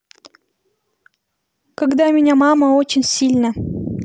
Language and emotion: Russian, neutral